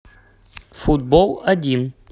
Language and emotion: Russian, neutral